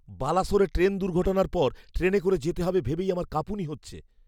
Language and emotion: Bengali, fearful